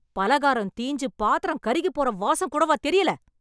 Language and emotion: Tamil, angry